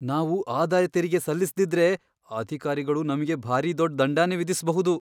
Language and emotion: Kannada, fearful